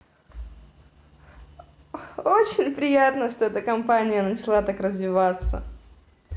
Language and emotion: Russian, positive